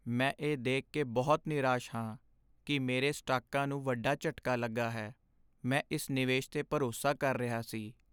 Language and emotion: Punjabi, sad